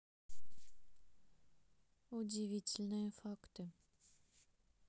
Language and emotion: Russian, neutral